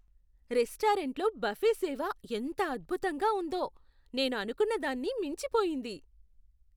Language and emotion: Telugu, surprised